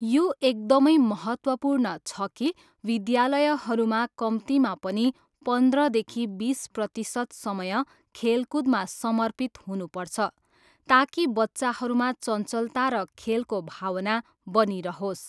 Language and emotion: Nepali, neutral